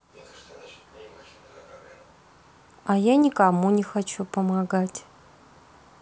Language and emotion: Russian, neutral